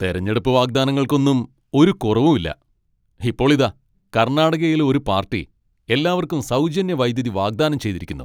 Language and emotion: Malayalam, angry